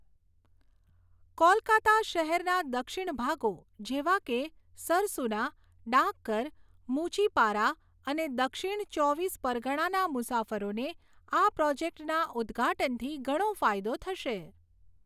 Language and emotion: Gujarati, neutral